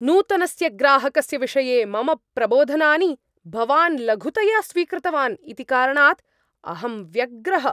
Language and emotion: Sanskrit, angry